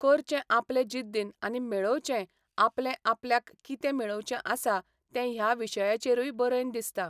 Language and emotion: Goan Konkani, neutral